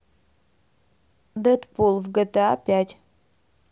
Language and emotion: Russian, neutral